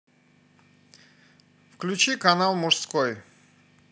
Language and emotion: Russian, neutral